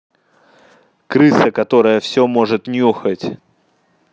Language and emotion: Russian, angry